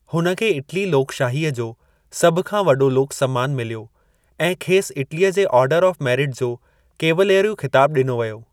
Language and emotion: Sindhi, neutral